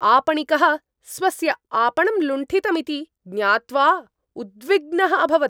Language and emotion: Sanskrit, angry